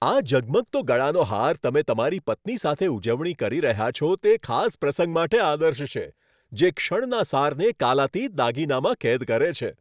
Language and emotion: Gujarati, happy